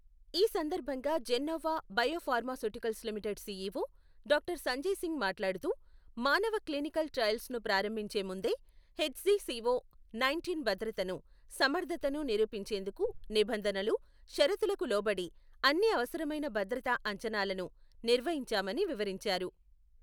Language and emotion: Telugu, neutral